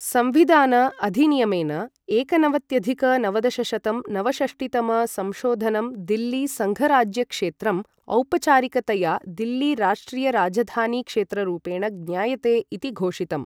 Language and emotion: Sanskrit, neutral